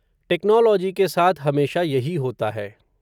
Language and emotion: Hindi, neutral